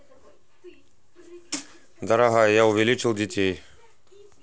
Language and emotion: Russian, neutral